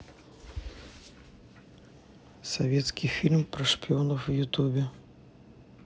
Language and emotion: Russian, neutral